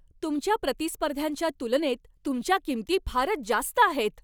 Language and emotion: Marathi, angry